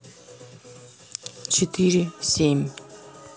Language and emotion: Russian, neutral